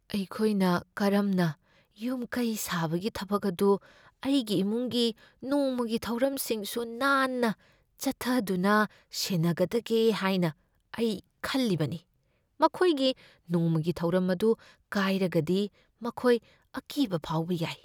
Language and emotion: Manipuri, fearful